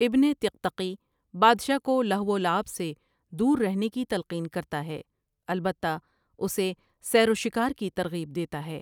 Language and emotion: Urdu, neutral